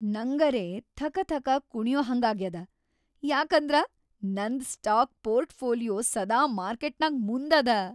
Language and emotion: Kannada, happy